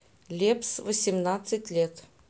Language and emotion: Russian, neutral